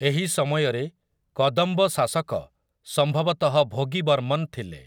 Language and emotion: Odia, neutral